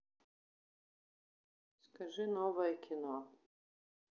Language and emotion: Russian, neutral